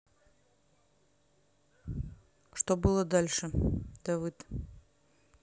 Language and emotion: Russian, neutral